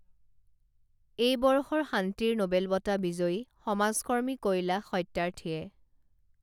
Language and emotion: Assamese, neutral